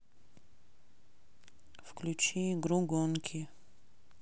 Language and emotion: Russian, neutral